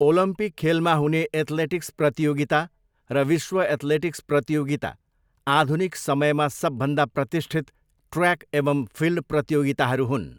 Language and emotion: Nepali, neutral